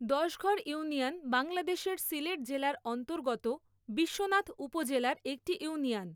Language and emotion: Bengali, neutral